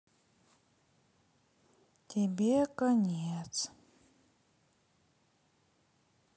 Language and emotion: Russian, sad